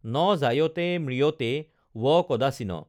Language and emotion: Assamese, neutral